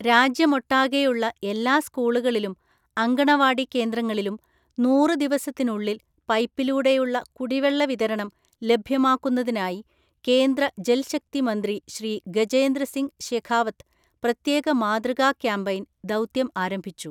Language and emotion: Malayalam, neutral